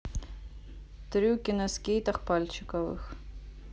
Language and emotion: Russian, neutral